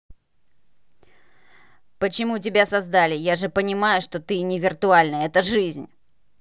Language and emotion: Russian, angry